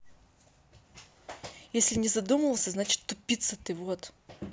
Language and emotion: Russian, angry